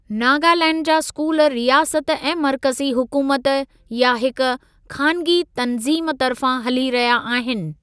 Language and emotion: Sindhi, neutral